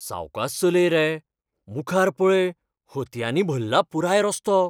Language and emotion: Goan Konkani, fearful